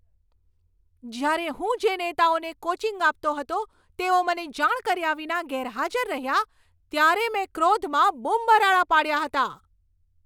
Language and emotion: Gujarati, angry